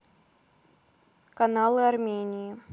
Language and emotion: Russian, neutral